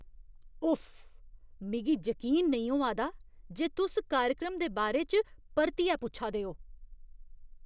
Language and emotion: Dogri, disgusted